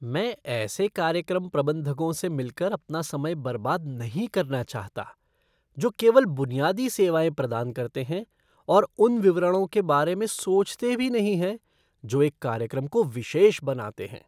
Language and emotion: Hindi, disgusted